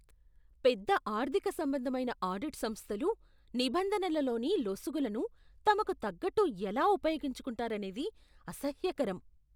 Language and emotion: Telugu, disgusted